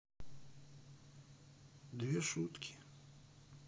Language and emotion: Russian, neutral